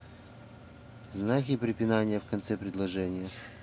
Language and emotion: Russian, neutral